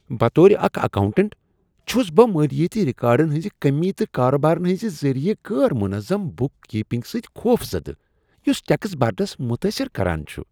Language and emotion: Kashmiri, disgusted